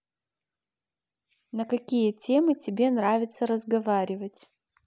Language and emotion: Russian, neutral